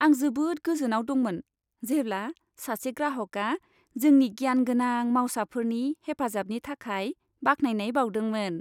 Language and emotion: Bodo, happy